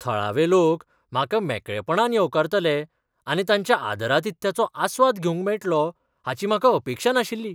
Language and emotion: Goan Konkani, surprised